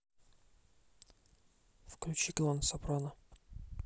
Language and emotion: Russian, neutral